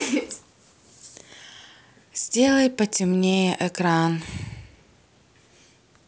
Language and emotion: Russian, sad